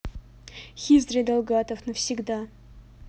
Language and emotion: Russian, neutral